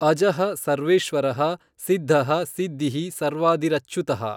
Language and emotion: Kannada, neutral